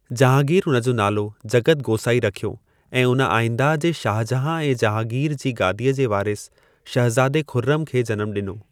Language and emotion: Sindhi, neutral